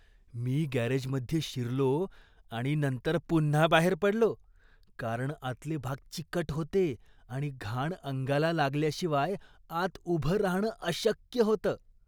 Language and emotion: Marathi, disgusted